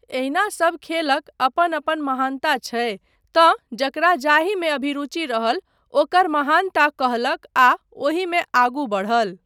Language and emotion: Maithili, neutral